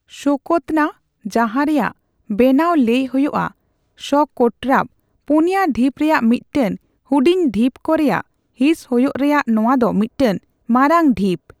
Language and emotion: Santali, neutral